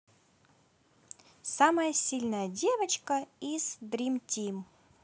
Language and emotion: Russian, positive